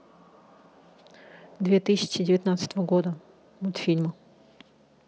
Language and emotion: Russian, neutral